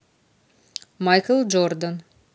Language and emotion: Russian, neutral